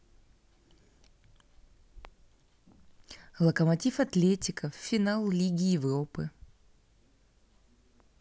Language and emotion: Russian, neutral